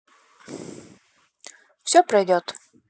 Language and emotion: Russian, neutral